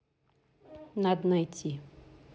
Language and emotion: Russian, neutral